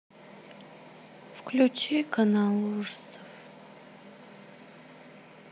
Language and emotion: Russian, sad